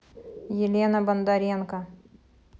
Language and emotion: Russian, neutral